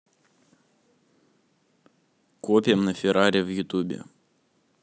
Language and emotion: Russian, neutral